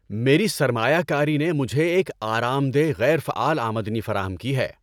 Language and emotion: Urdu, happy